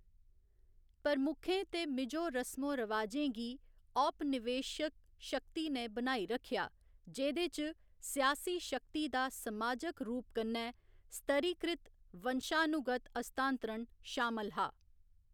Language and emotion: Dogri, neutral